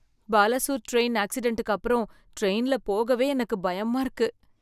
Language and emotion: Tamil, fearful